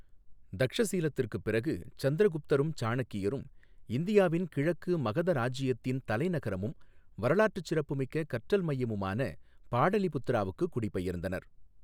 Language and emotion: Tamil, neutral